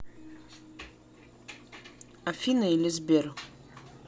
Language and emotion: Russian, neutral